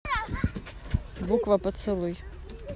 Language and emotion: Russian, neutral